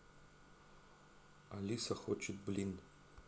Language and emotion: Russian, neutral